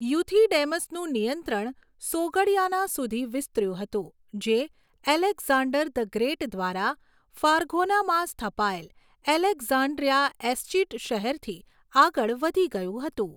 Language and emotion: Gujarati, neutral